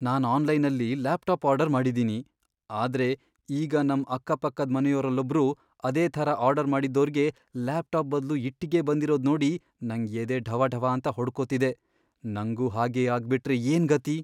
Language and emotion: Kannada, fearful